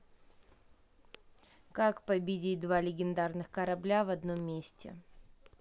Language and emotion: Russian, neutral